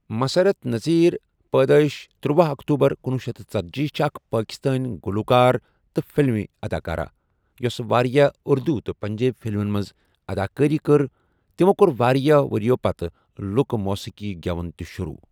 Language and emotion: Kashmiri, neutral